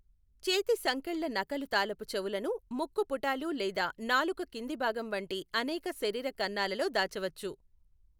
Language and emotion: Telugu, neutral